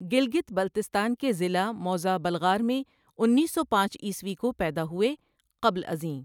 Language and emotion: Urdu, neutral